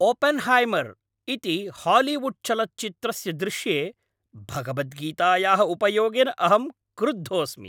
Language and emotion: Sanskrit, angry